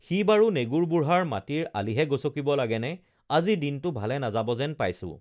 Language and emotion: Assamese, neutral